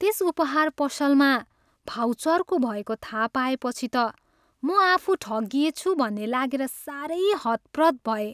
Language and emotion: Nepali, sad